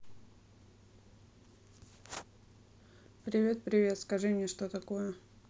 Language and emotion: Russian, neutral